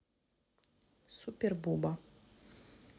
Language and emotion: Russian, neutral